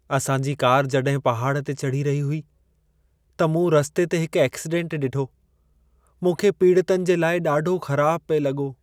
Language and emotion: Sindhi, sad